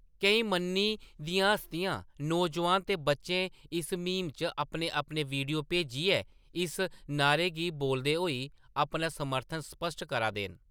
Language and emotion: Dogri, neutral